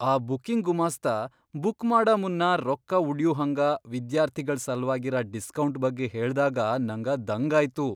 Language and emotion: Kannada, surprised